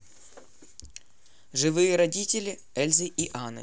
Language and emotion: Russian, neutral